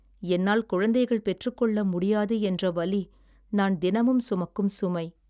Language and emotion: Tamil, sad